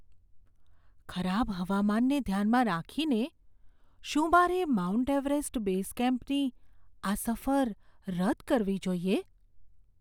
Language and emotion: Gujarati, fearful